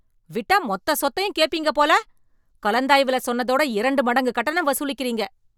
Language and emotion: Tamil, angry